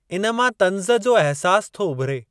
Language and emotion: Sindhi, neutral